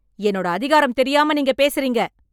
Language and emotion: Tamil, angry